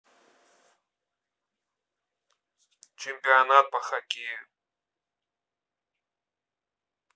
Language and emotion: Russian, neutral